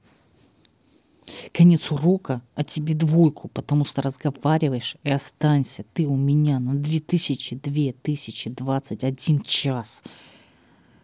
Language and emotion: Russian, angry